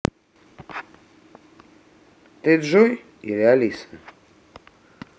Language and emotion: Russian, neutral